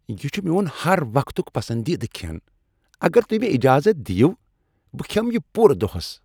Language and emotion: Kashmiri, happy